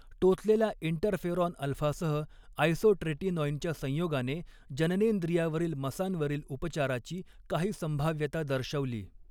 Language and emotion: Marathi, neutral